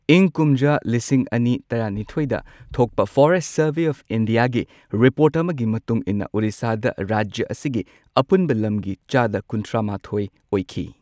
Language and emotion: Manipuri, neutral